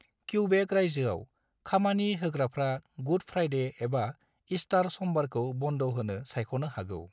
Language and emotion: Bodo, neutral